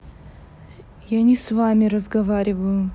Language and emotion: Russian, neutral